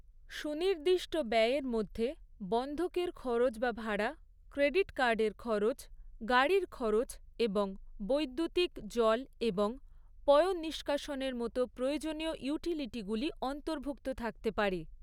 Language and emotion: Bengali, neutral